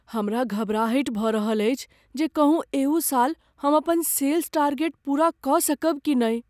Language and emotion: Maithili, fearful